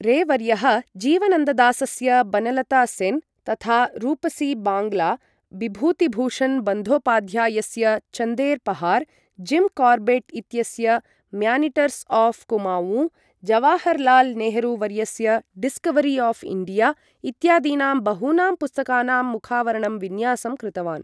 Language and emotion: Sanskrit, neutral